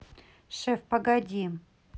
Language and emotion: Russian, neutral